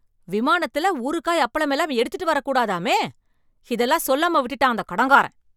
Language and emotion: Tamil, angry